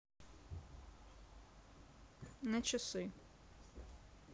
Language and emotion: Russian, neutral